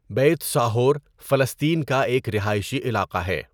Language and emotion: Urdu, neutral